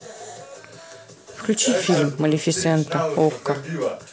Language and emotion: Russian, neutral